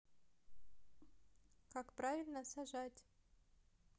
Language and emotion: Russian, neutral